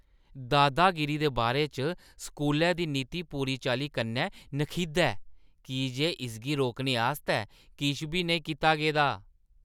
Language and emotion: Dogri, disgusted